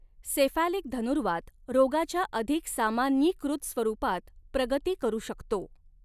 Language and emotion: Marathi, neutral